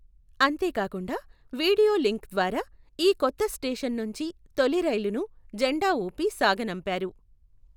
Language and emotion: Telugu, neutral